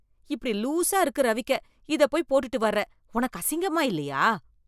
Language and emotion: Tamil, disgusted